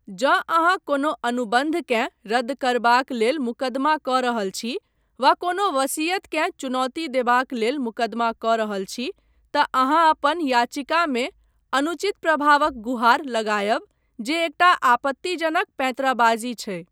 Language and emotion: Maithili, neutral